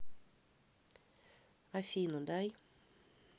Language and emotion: Russian, angry